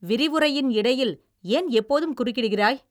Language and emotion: Tamil, angry